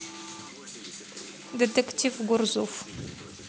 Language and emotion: Russian, neutral